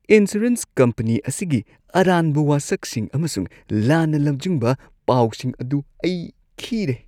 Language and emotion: Manipuri, disgusted